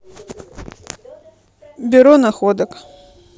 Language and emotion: Russian, neutral